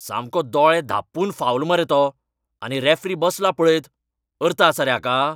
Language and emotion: Goan Konkani, angry